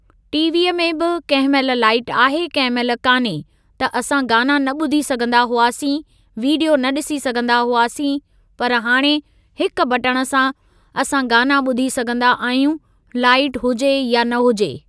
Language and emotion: Sindhi, neutral